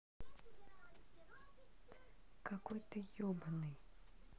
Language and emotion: Russian, neutral